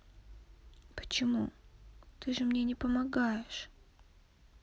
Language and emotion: Russian, sad